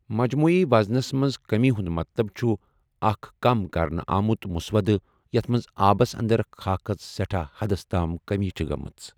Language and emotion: Kashmiri, neutral